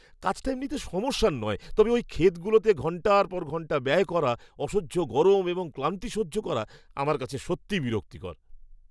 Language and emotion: Bengali, disgusted